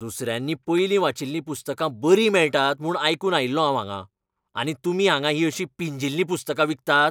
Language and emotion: Goan Konkani, angry